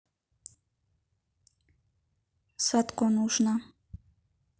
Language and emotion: Russian, neutral